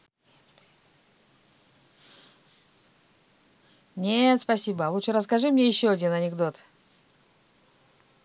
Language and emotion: Russian, neutral